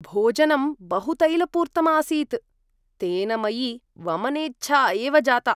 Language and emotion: Sanskrit, disgusted